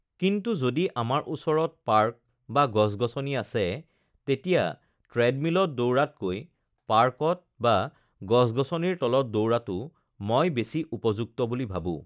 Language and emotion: Assamese, neutral